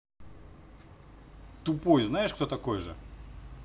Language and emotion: Russian, neutral